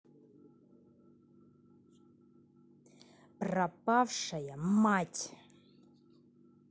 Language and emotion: Russian, angry